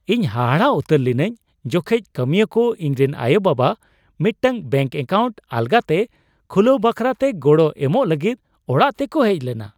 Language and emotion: Santali, surprised